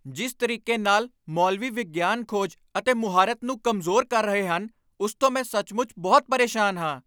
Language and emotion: Punjabi, angry